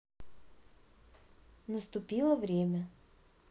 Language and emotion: Russian, neutral